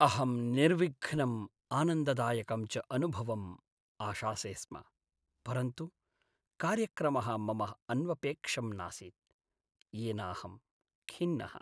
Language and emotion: Sanskrit, sad